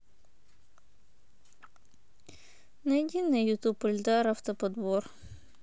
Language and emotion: Russian, sad